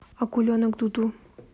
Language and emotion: Russian, neutral